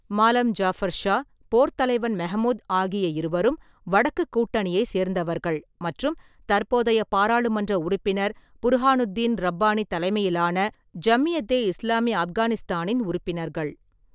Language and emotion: Tamil, neutral